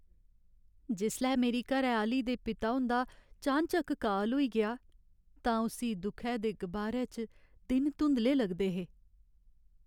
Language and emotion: Dogri, sad